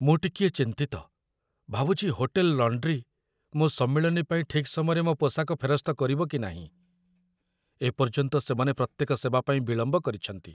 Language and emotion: Odia, fearful